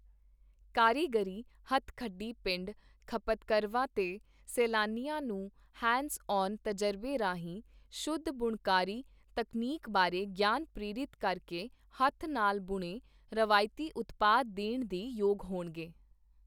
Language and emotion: Punjabi, neutral